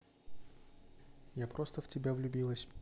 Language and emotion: Russian, neutral